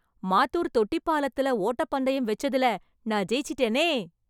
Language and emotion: Tamil, happy